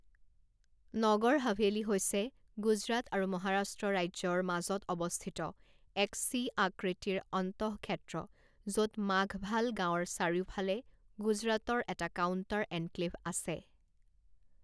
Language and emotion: Assamese, neutral